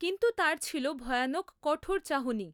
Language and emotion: Bengali, neutral